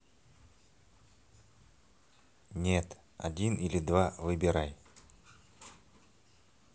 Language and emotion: Russian, neutral